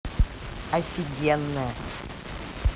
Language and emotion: Russian, positive